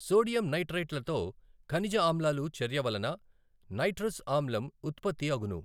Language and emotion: Telugu, neutral